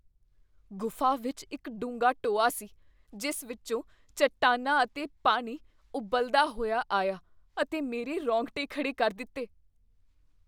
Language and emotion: Punjabi, fearful